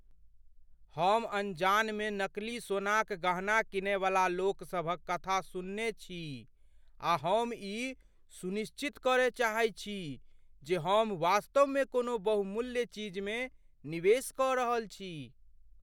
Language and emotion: Maithili, fearful